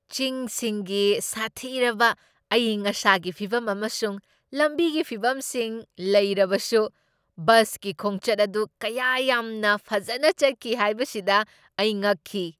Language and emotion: Manipuri, surprised